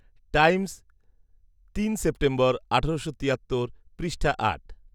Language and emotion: Bengali, neutral